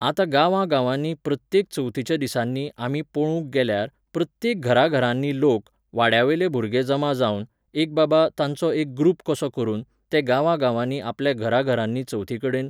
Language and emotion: Goan Konkani, neutral